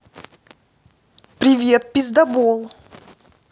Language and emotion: Russian, angry